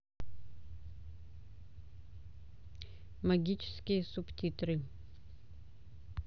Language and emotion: Russian, neutral